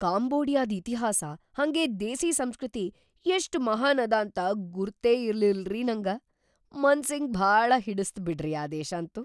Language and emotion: Kannada, surprised